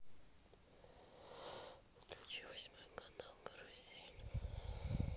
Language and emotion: Russian, neutral